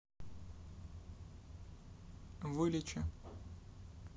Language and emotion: Russian, neutral